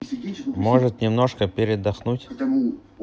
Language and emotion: Russian, neutral